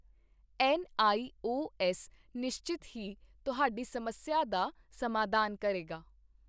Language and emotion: Punjabi, neutral